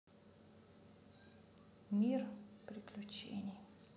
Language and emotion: Russian, sad